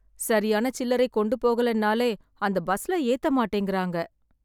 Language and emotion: Tamil, sad